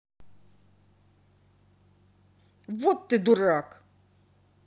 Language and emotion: Russian, angry